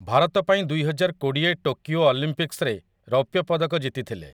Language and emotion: Odia, neutral